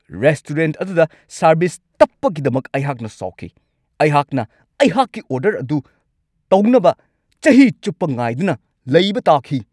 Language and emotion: Manipuri, angry